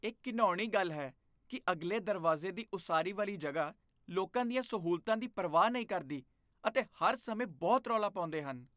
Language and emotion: Punjabi, disgusted